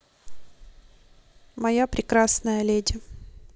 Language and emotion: Russian, neutral